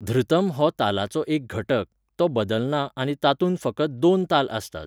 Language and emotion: Goan Konkani, neutral